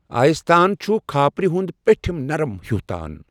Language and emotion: Kashmiri, neutral